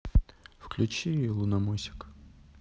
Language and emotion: Russian, neutral